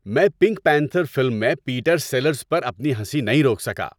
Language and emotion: Urdu, happy